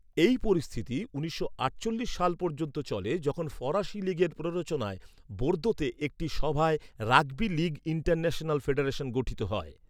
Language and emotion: Bengali, neutral